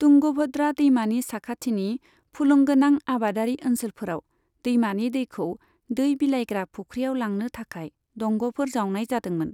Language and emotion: Bodo, neutral